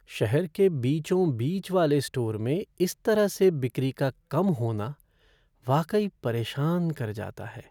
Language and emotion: Hindi, sad